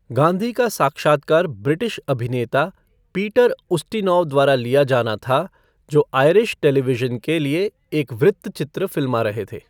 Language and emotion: Hindi, neutral